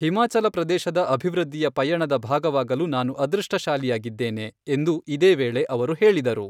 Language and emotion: Kannada, neutral